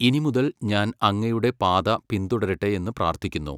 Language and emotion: Malayalam, neutral